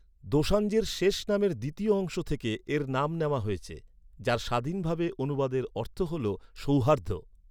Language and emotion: Bengali, neutral